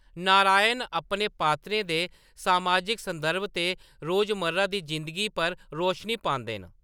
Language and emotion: Dogri, neutral